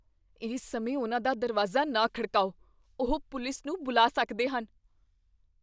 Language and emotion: Punjabi, fearful